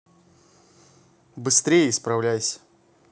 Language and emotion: Russian, neutral